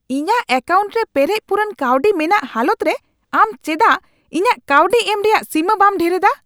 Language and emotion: Santali, angry